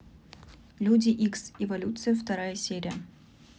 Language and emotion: Russian, neutral